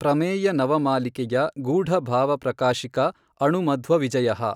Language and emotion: Kannada, neutral